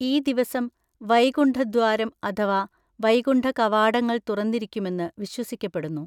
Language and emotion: Malayalam, neutral